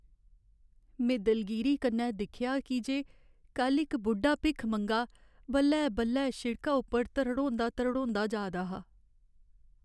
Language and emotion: Dogri, sad